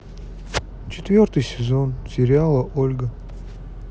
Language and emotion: Russian, neutral